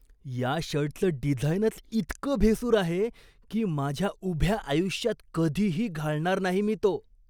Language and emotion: Marathi, disgusted